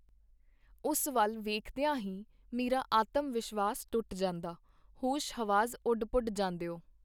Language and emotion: Punjabi, neutral